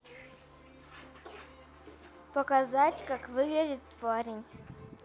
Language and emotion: Russian, neutral